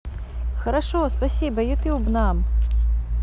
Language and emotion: Russian, positive